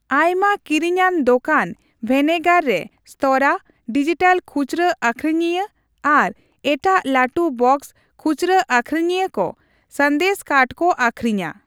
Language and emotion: Santali, neutral